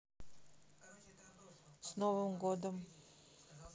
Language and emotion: Russian, neutral